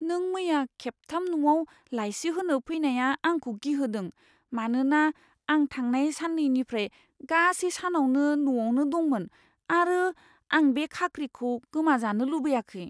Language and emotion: Bodo, fearful